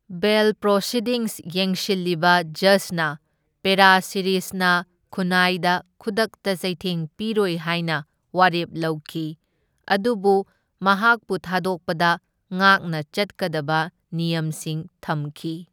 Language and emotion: Manipuri, neutral